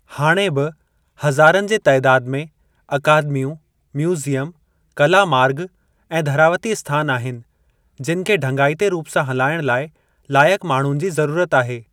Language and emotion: Sindhi, neutral